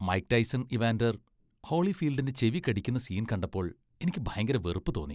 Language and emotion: Malayalam, disgusted